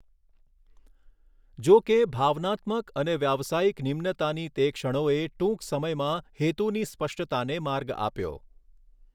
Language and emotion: Gujarati, neutral